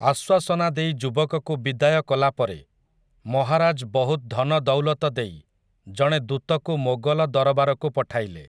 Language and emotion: Odia, neutral